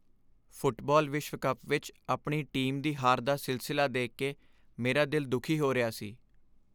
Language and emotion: Punjabi, sad